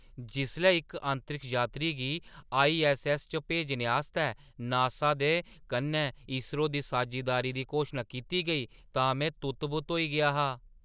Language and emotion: Dogri, surprised